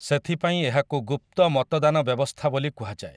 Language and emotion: Odia, neutral